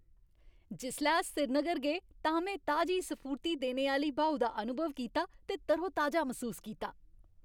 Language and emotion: Dogri, happy